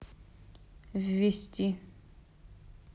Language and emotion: Russian, neutral